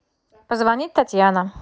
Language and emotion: Russian, neutral